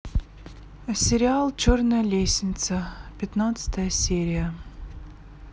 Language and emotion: Russian, neutral